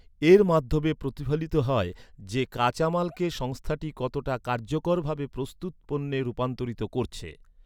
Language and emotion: Bengali, neutral